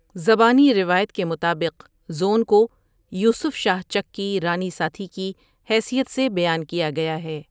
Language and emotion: Urdu, neutral